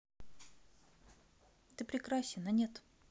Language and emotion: Russian, neutral